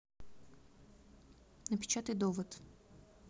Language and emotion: Russian, neutral